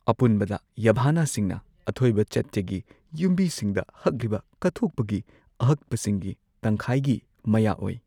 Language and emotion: Manipuri, neutral